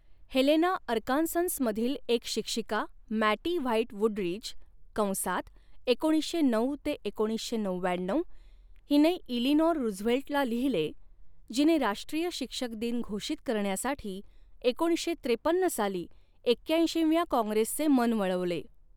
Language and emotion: Marathi, neutral